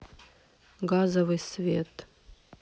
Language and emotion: Russian, neutral